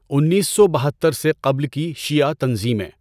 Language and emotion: Urdu, neutral